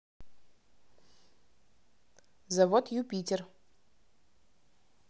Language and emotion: Russian, neutral